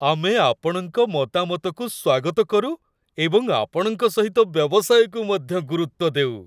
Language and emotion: Odia, happy